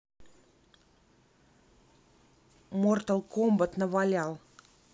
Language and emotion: Russian, neutral